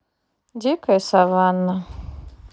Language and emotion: Russian, neutral